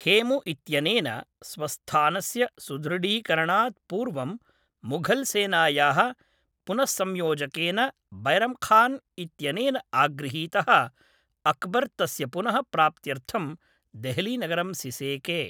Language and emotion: Sanskrit, neutral